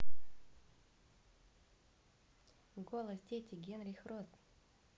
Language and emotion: Russian, neutral